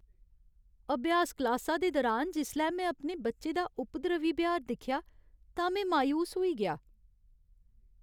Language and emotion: Dogri, sad